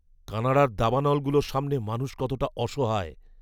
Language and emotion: Bengali, fearful